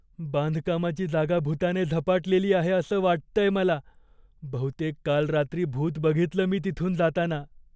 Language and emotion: Marathi, fearful